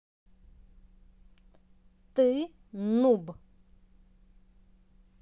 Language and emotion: Russian, angry